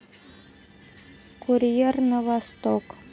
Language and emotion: Russian, neutral